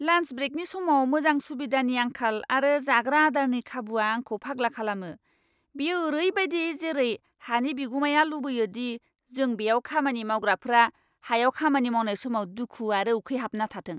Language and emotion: Bodo, angry